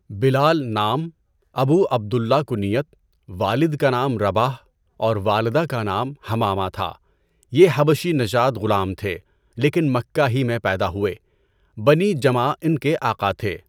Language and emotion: Urdu, neutral